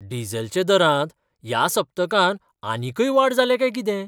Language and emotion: Goan Konkani, surprised